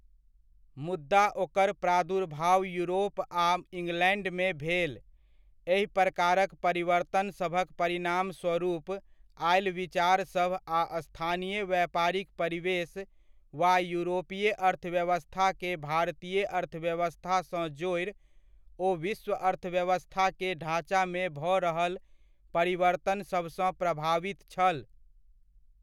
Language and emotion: Maithili, neutral